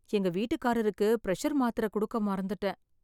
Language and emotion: Tamil, sad